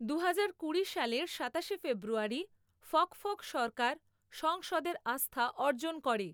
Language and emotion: Bengali, neutral